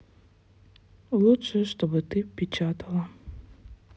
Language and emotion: Russian, sad